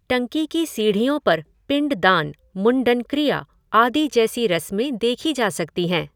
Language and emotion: Hindi, neutral